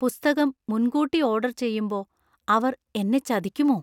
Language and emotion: Malayalam, fearful